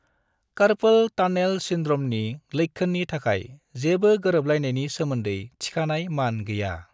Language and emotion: Bodo, neutral